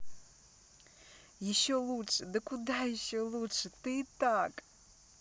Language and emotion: Russian, positive